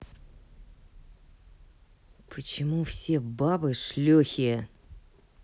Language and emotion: Russian, angry